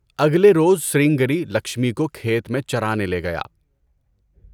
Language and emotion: Urdu, neutral